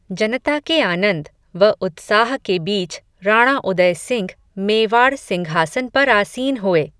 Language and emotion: Hindi, neutral